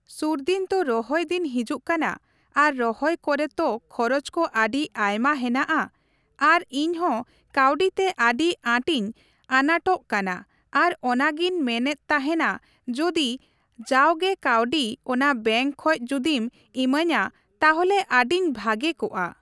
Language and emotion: Santali, neutral